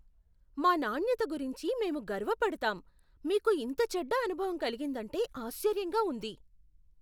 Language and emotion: Telugu, surprised